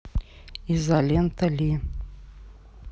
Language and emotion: Russian, neutral